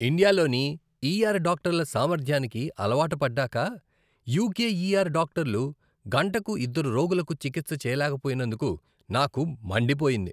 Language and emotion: Telugu, disgusted